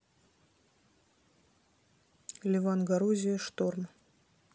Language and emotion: Russian, neutral